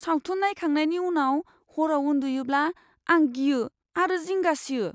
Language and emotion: Bodo, fearful